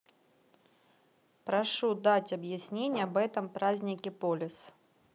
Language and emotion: Russian, neutral